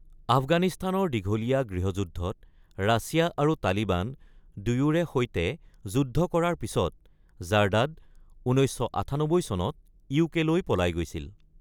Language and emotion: Assamese, neutral